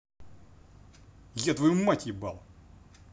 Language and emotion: Russian, angry